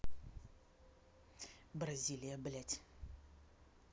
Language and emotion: Russian, angry